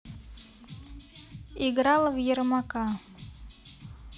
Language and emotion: Russian, neutral